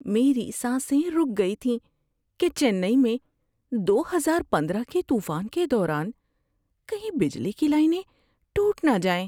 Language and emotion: Urdu, fearful